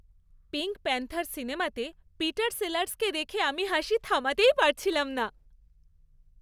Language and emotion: Bengali, happy